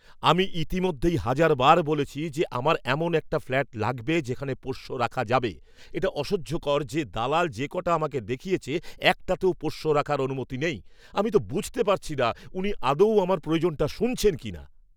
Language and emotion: Bengali, angry